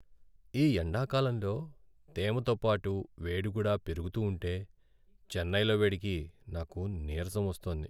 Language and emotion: Telugu, sad